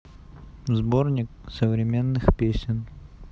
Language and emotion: Russian, neutral